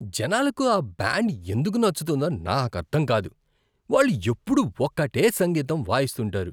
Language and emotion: Telugu, disgusted